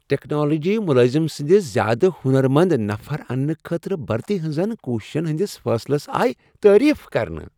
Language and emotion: Kashmiri, happy